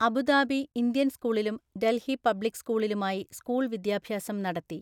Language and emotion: Malayalam, neutral